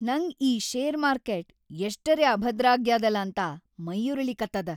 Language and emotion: Kannada, angry